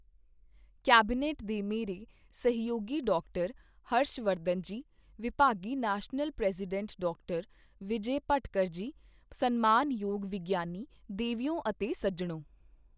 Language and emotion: Punjabi, neutral